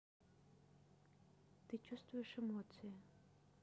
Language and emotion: Russian, neutral